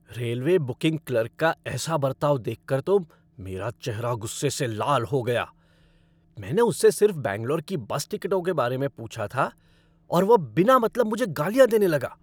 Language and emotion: Hindi, angry